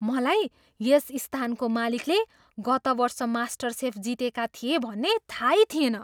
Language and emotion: Nepali, surprised